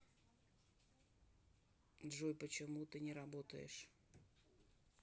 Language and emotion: Russian, neutral